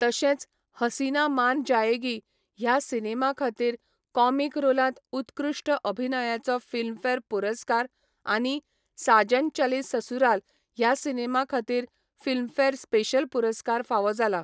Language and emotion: Goan Konkani, neutral